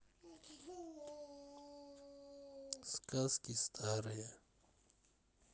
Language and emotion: Russian, neutral